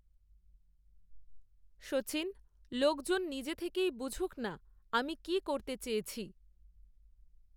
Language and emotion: Bengali, neutral